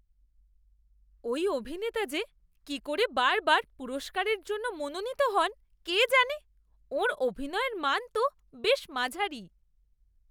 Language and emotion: Bengali, disgusted